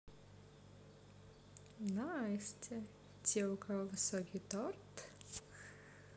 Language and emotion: Russian, positive